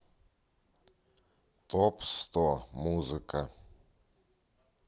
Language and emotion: Russian, neutral